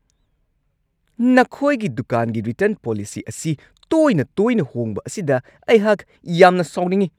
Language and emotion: Manipuri, angry